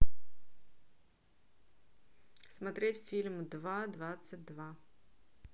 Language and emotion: Russian, neutral